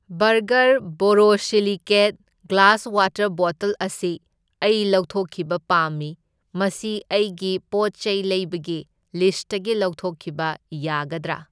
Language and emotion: Manipuri, neutral